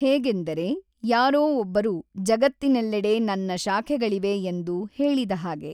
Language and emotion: Kannada, neutral